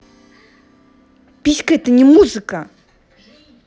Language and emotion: Russian, angry